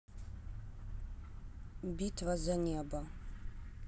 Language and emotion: Russian, neutral